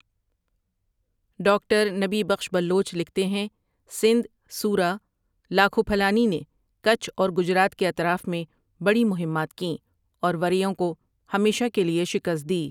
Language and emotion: Urdu, neutral